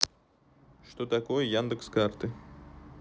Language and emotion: Russian, neutral